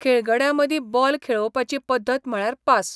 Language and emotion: Goan Konkani, neutral